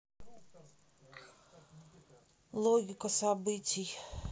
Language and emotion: Russian, neutral